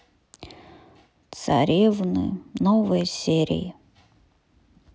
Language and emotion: Russian, sad